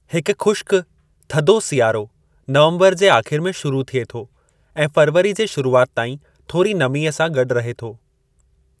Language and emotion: Sindhi, neutral